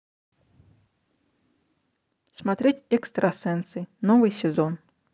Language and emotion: Russian, neutral